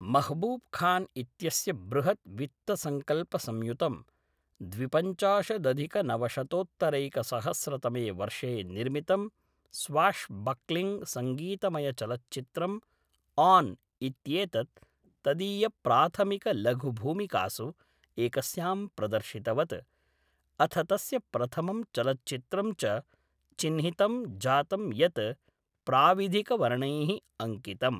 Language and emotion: Sanskrit, neutral